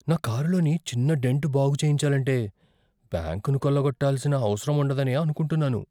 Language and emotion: Telugu, fearful